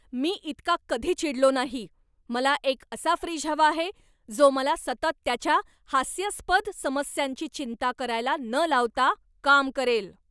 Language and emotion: Marathi, angry